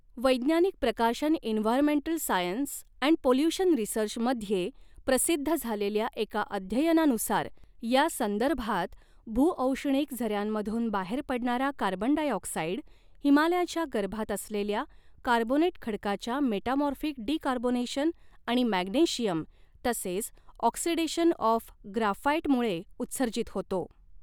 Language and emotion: Marathi, neutral